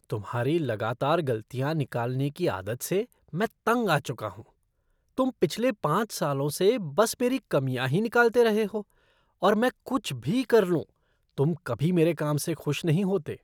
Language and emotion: Hindi, disgusted